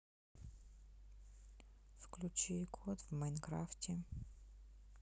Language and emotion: Russian, sad